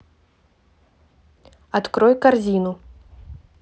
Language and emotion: Russian, neutral